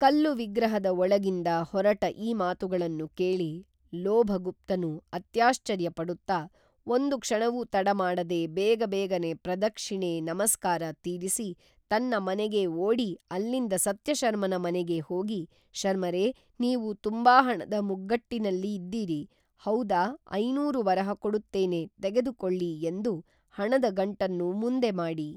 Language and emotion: Kannada, neutral